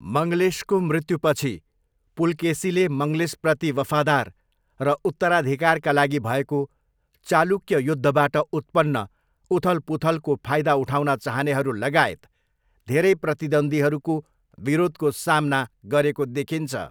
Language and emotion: Nepali, neutral